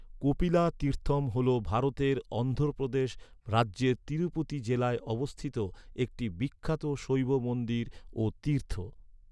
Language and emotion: Bengali, neutral